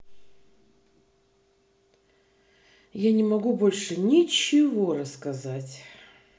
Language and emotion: Russian, neutral